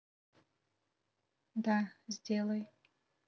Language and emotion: Russian, neutral